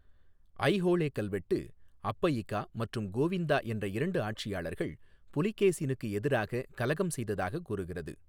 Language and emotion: Tamil, neutral